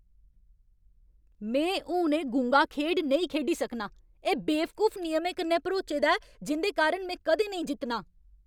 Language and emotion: Dogri, angry